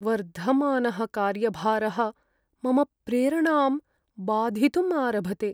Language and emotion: Sanskrit, sad